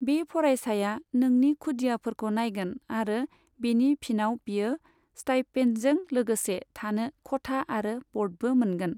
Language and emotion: Bodo, neutral